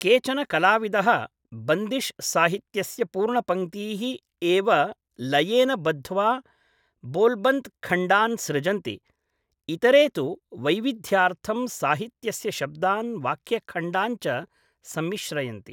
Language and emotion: Sanskrit, neutral